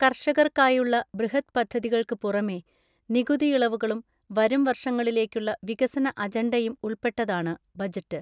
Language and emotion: Malayalam, neutral